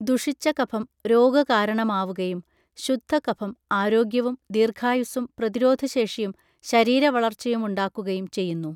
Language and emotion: Malayalam, neutral